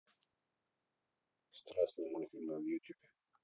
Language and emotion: Russian, neutral